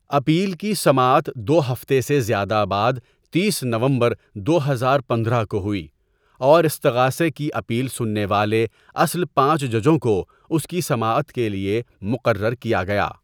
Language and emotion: Urdu, neutral